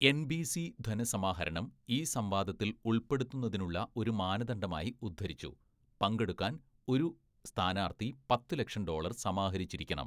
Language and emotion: Malayalam, neutral